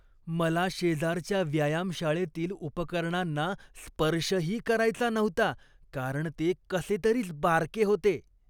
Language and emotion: Marathi, disgusted